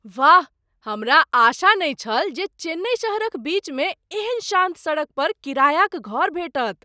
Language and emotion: Maithili, surprised